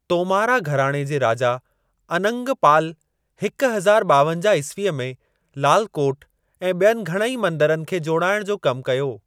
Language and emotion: Sindhi, neutral